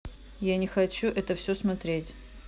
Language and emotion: Russian, angry